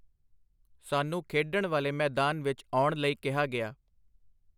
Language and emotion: Punjabi, neutral